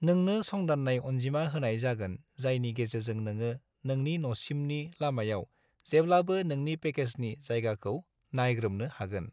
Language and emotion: Bodo, neutral